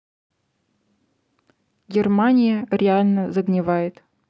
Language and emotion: Russian, neutral